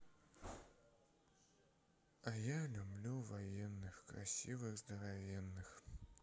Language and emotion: Russian, sad